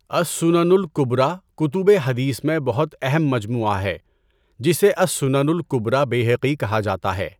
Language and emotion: Urdu, neutral